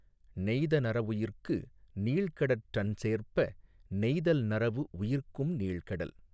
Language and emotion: Tamil, neutral